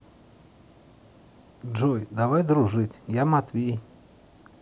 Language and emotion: Russian, neutral